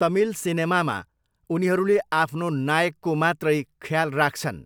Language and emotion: Nepali, neutral